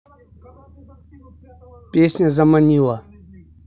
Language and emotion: Russian, neutral